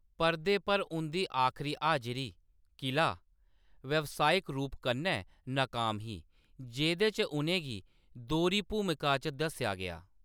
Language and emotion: Dogri, neutral